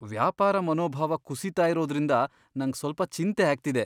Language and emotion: Kannada, fearful